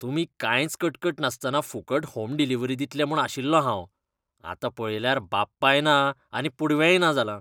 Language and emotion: Goan Konkani, disgusted